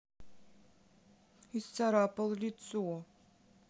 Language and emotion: Russian, sad